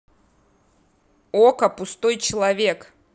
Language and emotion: Russian, neutral